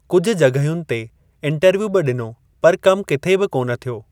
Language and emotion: Sindhi, neutral